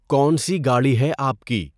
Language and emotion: Urdu, neutral